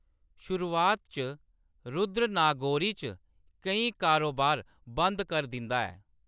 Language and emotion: Dogri, neutral